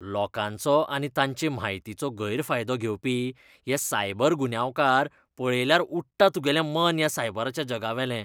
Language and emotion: Goan Konkani, disgusted